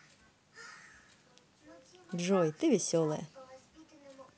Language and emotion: Russian, positive